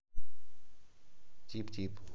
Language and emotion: Russian, neutral